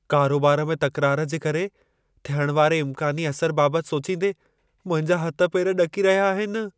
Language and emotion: Sindhi, fearful